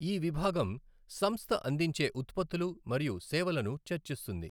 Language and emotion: Telugu, neutral